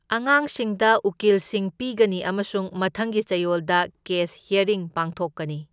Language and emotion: Manipuri, neutral